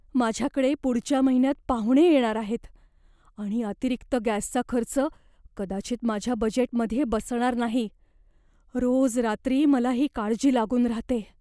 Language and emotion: Marathi, fearful